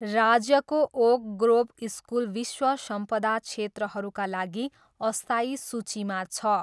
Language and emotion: Nepali, neutral